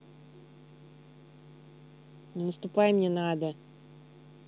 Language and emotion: Russian, angry